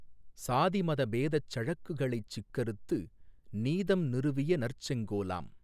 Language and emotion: Tamil, neutral